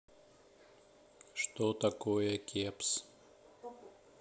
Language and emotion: Russian, neutral